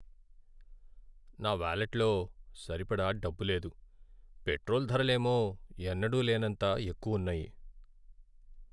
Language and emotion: Telugu, sad